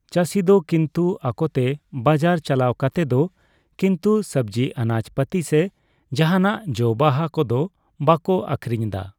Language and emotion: Santali, neutral